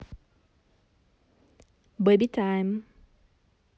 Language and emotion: Russian, positive